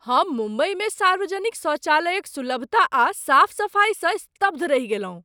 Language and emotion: Maithili, surprised